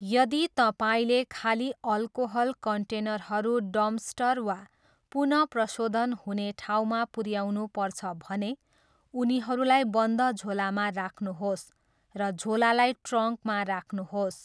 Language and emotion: Nepali, neutral